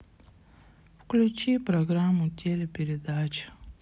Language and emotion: Russian, sad